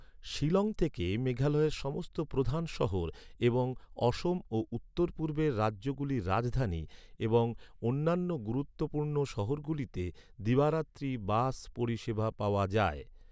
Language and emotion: Bengali, neutral